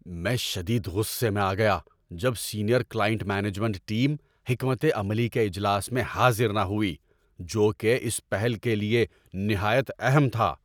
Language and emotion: Urdu, angry